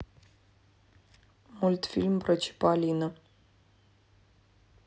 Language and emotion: Russian, neutral